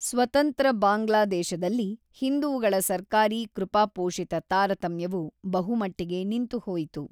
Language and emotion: Kannada, neutral